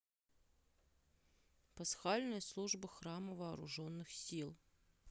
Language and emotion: Russian, neutral